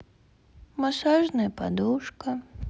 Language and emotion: Russian, sad